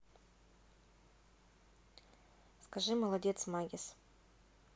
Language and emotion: Russian, neutral